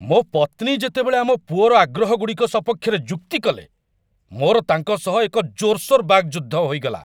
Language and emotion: Odia, angry